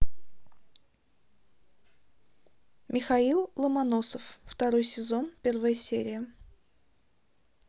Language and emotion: Russian, neutral